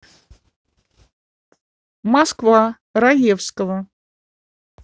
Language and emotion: Russian, neutral